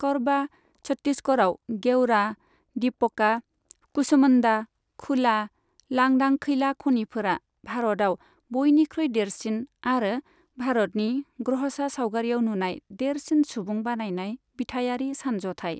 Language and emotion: Bodo, neutral